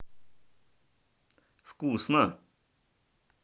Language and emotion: Russian, positive